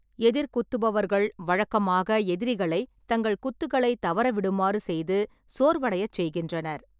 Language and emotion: Tamil, neutral